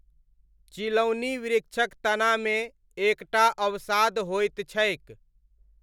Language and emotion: Maithili, neutral